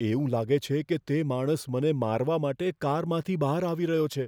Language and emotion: Gujarati, fearful